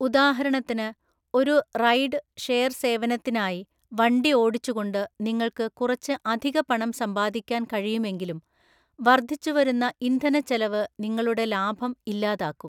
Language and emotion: Malayalam, neutral